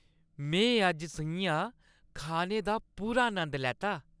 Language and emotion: Dogri, happy